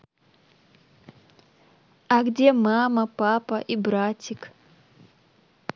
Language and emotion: Russian, neutral